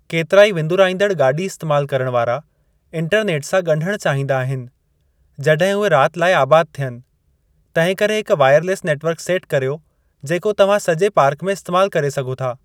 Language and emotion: Sindhi, neutral